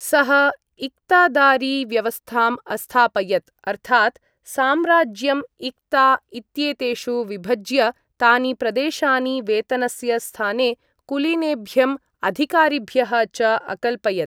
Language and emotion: Sanskrit, neutral